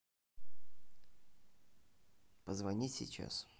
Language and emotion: Russian, neutral